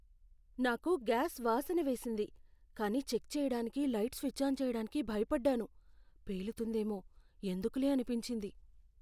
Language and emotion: Telugu, fearful